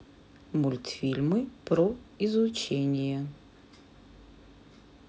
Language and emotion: Russian, neutral